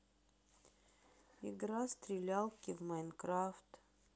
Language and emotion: Russian, sad